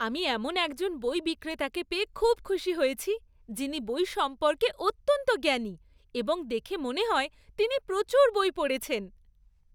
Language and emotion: Bengali, happy